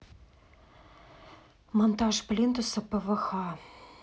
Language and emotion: Russian, neutral